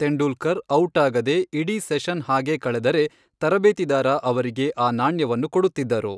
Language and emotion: Kannada, neutral